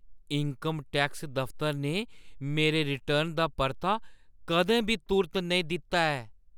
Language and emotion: Dogri, surprised